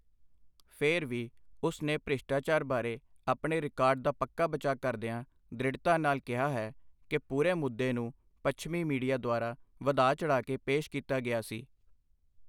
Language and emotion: Punjabi, neutral